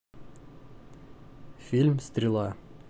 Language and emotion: Russian, neutral